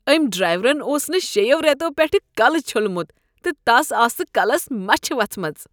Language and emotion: Kashmiri, disgusted